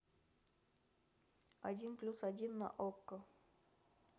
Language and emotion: Russian, neutral